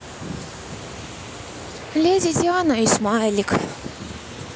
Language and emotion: Russian, sad